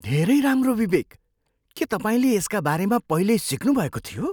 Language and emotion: Nepali, surprised